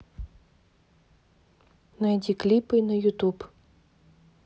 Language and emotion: Russian, neutral